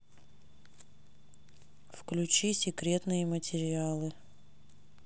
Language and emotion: Russian, neutral